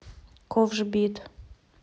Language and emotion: Russian, neutral